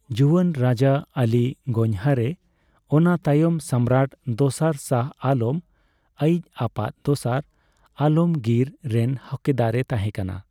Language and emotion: Santali, neutral